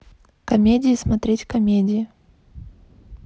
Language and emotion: Russian, neutral